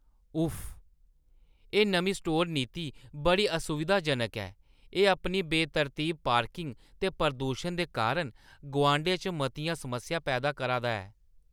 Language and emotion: Dogri, disgusted